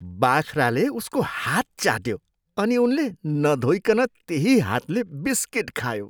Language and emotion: Nepali, disgusted